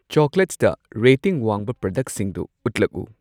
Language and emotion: Manipuri, neutral